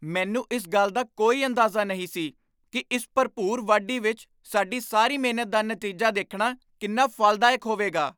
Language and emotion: Punjabi, surprised